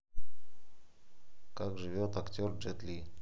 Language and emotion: Russian, neutral